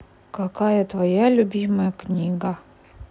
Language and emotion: Russian, neutral